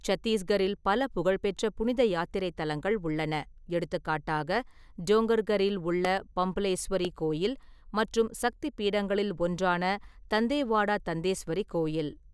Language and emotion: Tamil, neutral